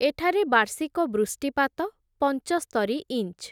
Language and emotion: Odia, neutral